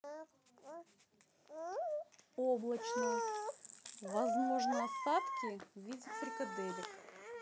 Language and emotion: Russian, neutral